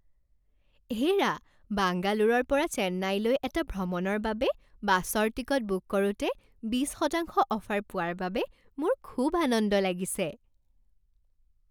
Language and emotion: Assamese, happy